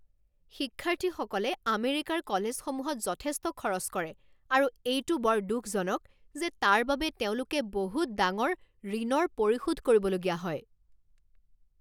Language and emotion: Assamese, angry